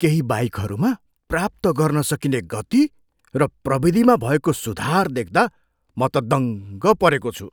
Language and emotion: Nepali, surprised